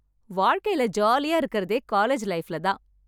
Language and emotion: Tamil, happy